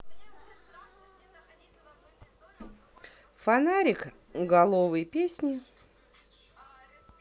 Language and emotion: Russian, neutral